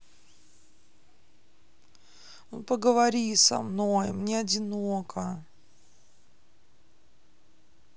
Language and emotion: Russian, sad